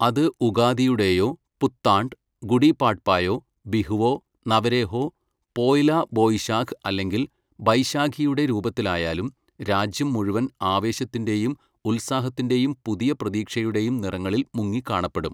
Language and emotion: Malayalam, neutral